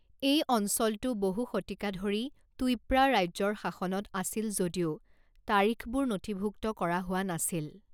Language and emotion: Assamese, neutral